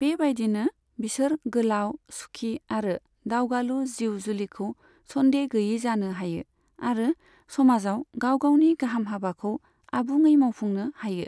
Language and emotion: Bodo, neutral